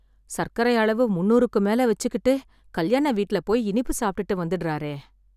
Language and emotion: Tamil, sad